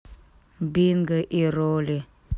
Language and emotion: Russian, sad